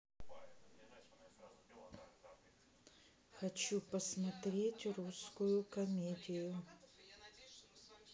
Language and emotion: Russian, neutral